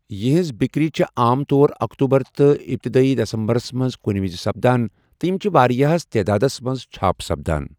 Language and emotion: Kashmiri, neutral